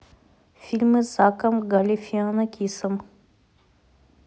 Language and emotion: Russian, neutral